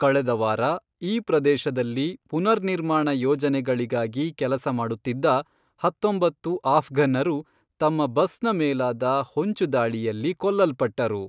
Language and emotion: Kannada, neutral